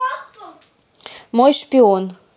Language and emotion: Russian, neutral